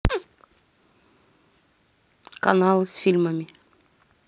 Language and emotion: Russian, neutral